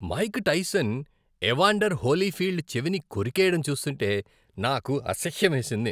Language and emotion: Telugu, disgusted